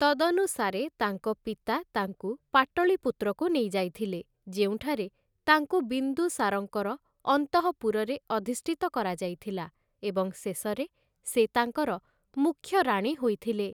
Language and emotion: Odia, neutral